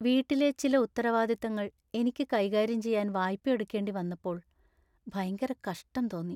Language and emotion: Malayalam, sad